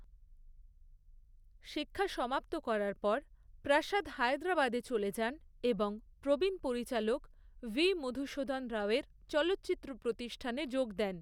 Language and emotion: Bengali, neutral